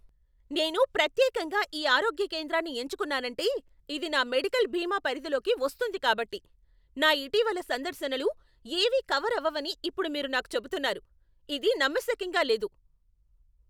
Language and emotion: Telugu, angry